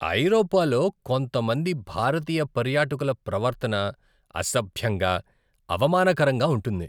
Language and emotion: Telugu, disgusted